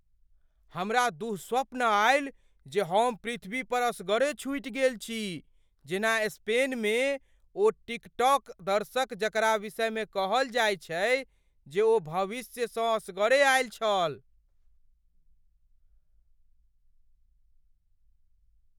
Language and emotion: Maithili, fearful